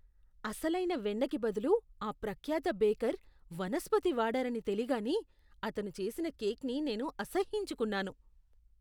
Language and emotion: Telugu, disgusted